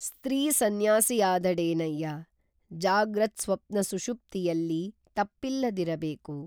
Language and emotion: Kannada, neutral